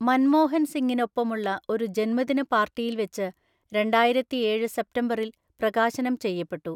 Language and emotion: Malayalam, neutral